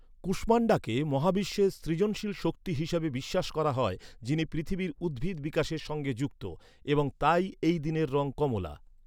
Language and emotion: Bengali, neutral